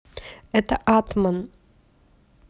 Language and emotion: Russian, neutral